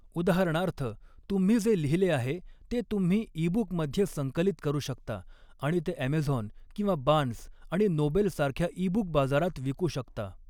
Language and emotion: Marathi, neutral